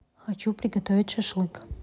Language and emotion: Russian, neutral